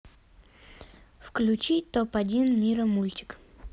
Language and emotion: Russian, neutral